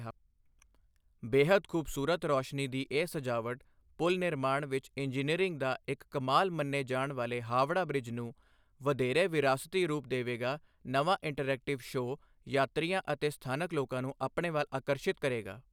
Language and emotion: Punjabi, neutral